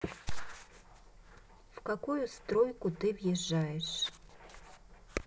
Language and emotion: Russian, neutral